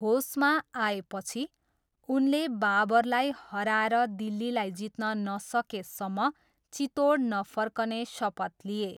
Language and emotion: Nepali, neutral